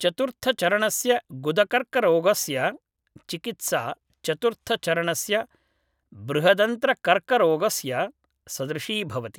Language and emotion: Sanskrit, neutral